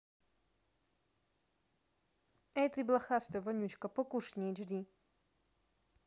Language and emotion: Russian, neutral